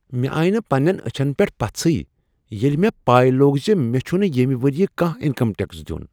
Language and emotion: Kashmiri, surprised